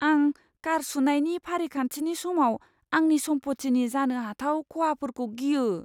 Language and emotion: Bodo, fearful